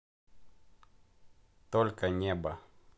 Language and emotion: Russian, neutral